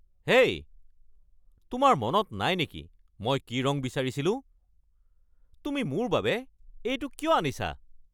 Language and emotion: Assamese, angry